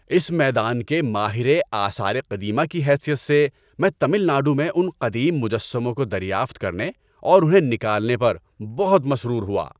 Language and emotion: Urdu, happy